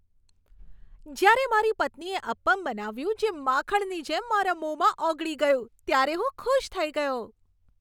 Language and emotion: Gujarati, happy